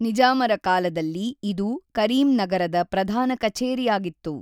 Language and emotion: Kannada, neutral